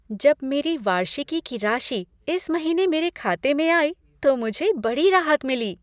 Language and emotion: Hindi, happy